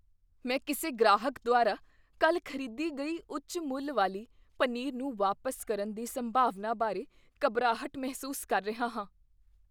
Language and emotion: Punjabi, fearful